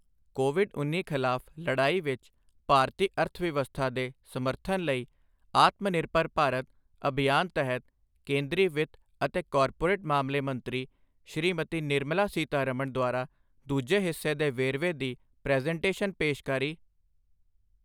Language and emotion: Punjabi, neutral